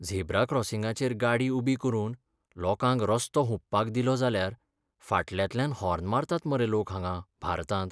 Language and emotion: Goan Konkani, sad